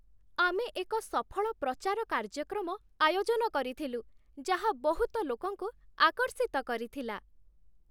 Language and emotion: Odia, happy